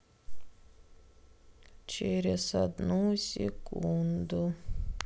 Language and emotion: Russian, sad